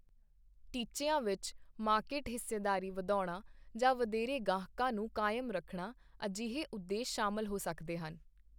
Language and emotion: Punjabi, neutral